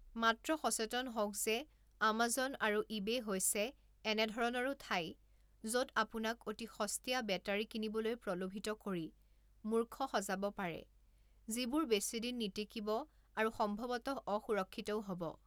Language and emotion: Assamese, neutral